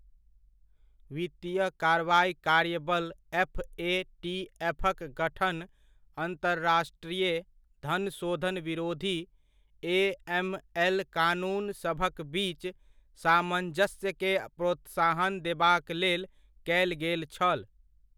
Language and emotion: Maithili, neutral